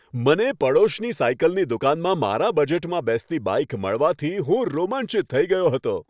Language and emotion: Gujarati, happy